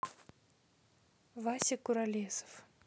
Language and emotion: Russian, neutral